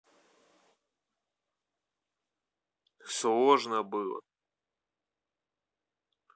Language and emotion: Russian, neutral